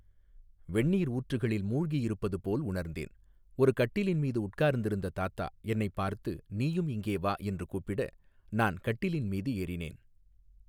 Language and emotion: Tamil, neutral